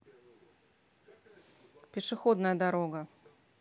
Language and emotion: Russian, neutral